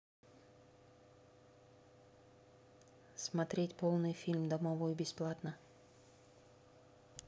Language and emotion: Russian, neutral